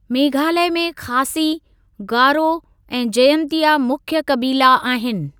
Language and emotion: Sindhi, neutral